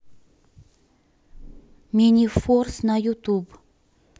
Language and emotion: Russian, neutral